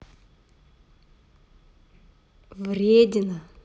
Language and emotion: Russian, positive